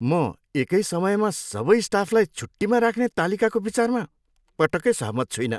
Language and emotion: Nepali, disgusted